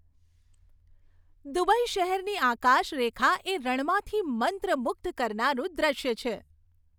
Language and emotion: Gujarati, happy